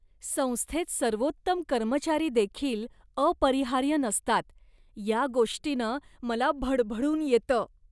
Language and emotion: Marathi, disgusted